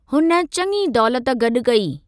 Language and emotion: Sindhi, neutral